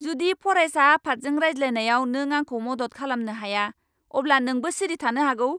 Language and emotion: Bodo, angry